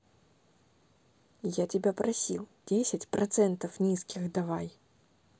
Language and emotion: Russian, angry